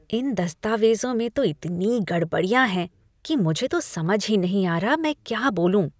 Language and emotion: Hindi, disgusted